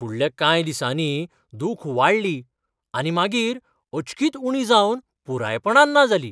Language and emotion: Goan Konkani, surprised